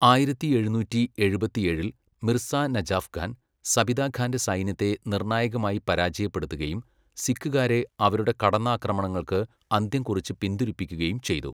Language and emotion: Malayalam, neutral